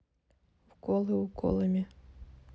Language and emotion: Russian, neutral